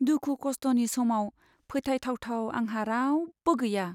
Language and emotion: Bodo, sad